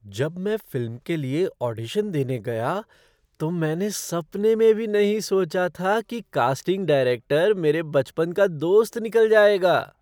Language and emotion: Hindi, surprised